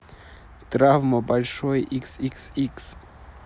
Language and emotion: Russian, neutral